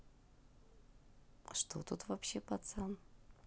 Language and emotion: Russian, neutral